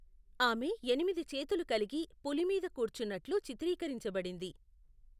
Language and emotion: Telugu, neutral